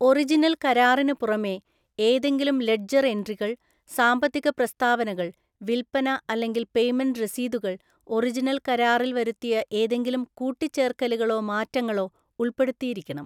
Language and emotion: Malayalam, neutral